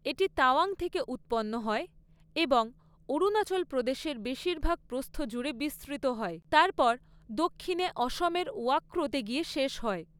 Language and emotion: Bengali, neutral